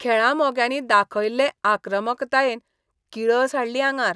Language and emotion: Goan Konkani, disgusted